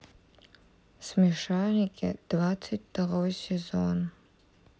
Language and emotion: Russian, sad